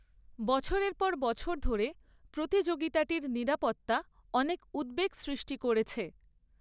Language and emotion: Bengali, neutral